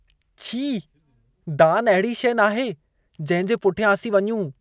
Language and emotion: Sindhi, disgusted